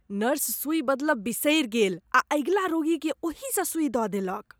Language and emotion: Maithili, disgusted